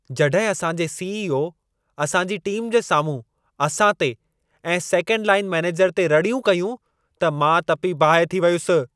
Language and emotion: Sindhi, angry